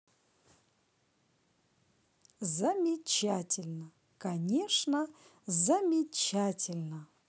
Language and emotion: Russian, positive